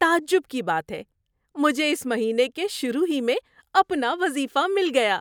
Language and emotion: Urdu, surprised